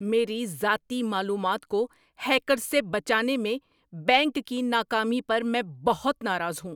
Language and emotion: Urdu, angry